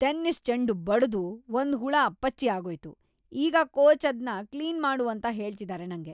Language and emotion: Kannada, disgusted